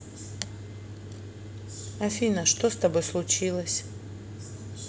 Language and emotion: Russian, neutral